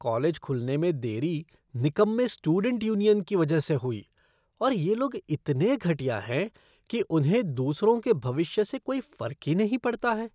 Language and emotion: Hindi, disgusted